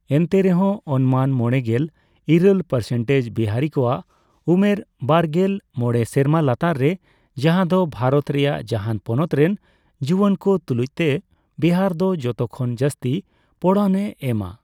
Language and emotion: Santali, neutral